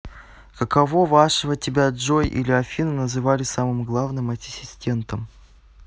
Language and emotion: Russian, neutral